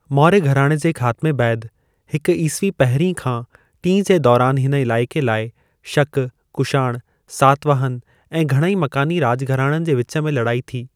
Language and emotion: Sindhi, neutral